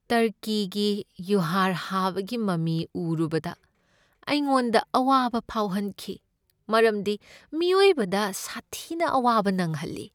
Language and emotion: Manipuri, sad